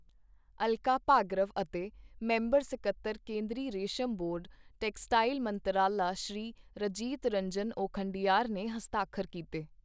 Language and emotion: Punjabi, neutral